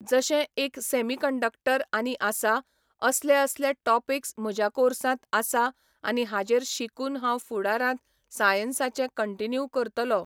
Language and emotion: Goan Konkani, neutral